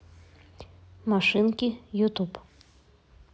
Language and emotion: Russian, neutral